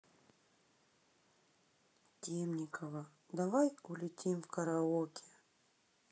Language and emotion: Russian, sad